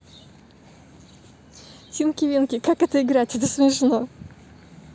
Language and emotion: Russian, positive